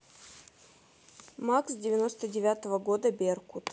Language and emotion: Russian, neutral